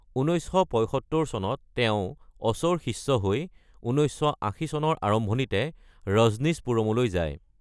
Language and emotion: Assamese, neutral